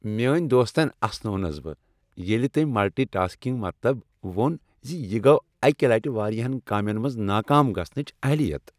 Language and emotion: Kashmiri, happy